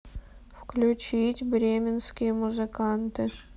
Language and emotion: Russian, neutral